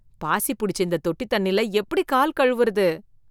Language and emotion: Tamil, disgusted